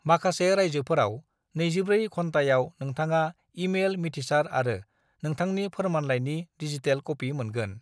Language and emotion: Bodo, neutral